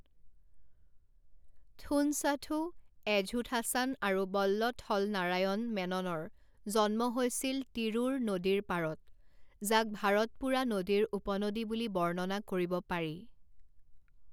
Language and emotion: Assamese, neutral